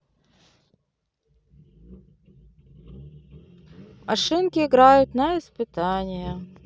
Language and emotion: Russian, neutral